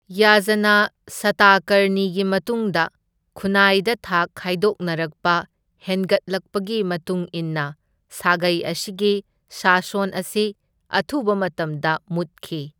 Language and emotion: Manipuri, neutral